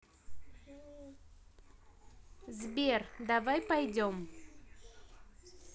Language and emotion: Russian, neutral